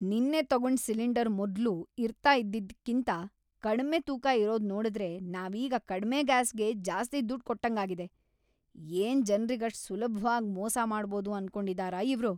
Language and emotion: Kannada, angry